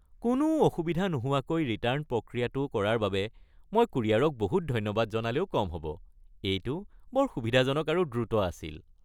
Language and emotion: Assamese, happy